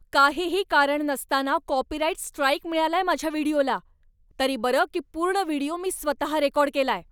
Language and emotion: Marathi, angry